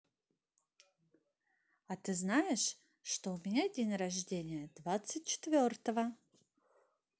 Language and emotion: Russian, positive